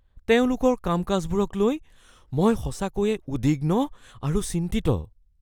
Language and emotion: Assamese, fearful